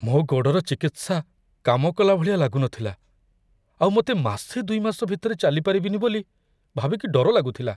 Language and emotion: Odia, fearful